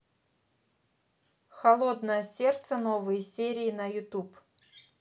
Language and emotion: Russian, neutral